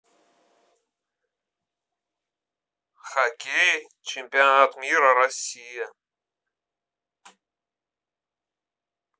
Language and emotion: Russian, neutral